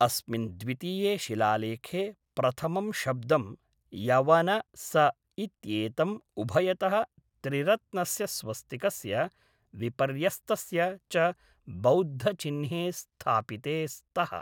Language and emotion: Sanskrit, neutral